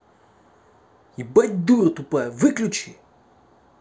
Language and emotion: Russian, angry